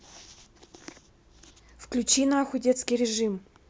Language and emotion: Russian, angry